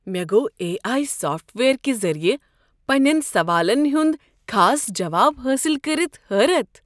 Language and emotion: Kashmiri, surprised